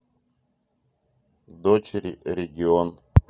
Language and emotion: Russian, neutral